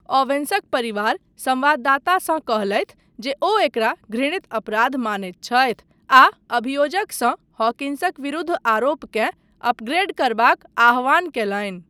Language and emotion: Maithili, neutral